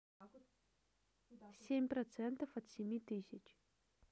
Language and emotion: Russian, neutral